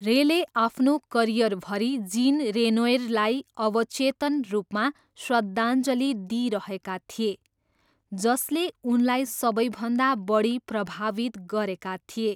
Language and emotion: Nepali, neutral